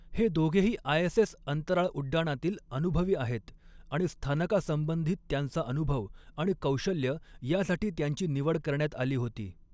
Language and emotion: Marathi, neutral